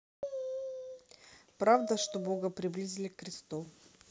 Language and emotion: Russian, neutral